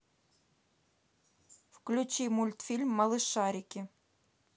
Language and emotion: Russian, neutral